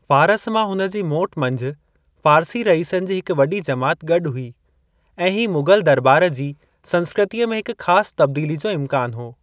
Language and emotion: Sindhi, neutral